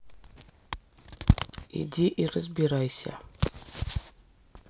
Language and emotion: Russian, neutral